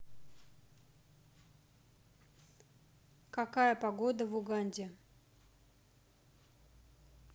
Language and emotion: Russian, neutral